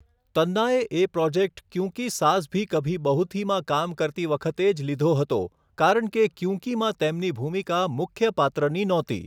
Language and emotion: Gujarati, neutral